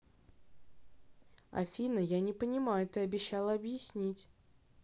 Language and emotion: Russian, neutral